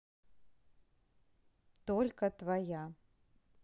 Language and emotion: Russian, neutral